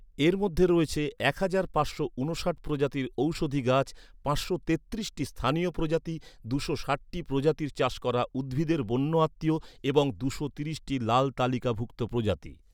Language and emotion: Bengali, neutral